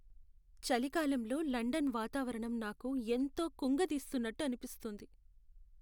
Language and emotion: Telugu, sad